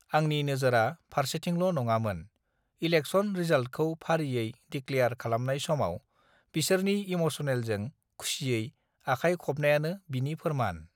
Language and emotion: Bodo, neutral